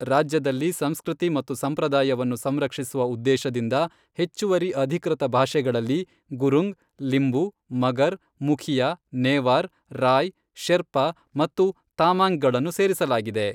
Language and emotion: Kannada, neutral